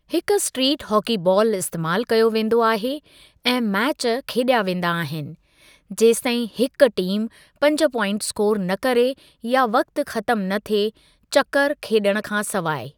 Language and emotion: Sindhi, neutral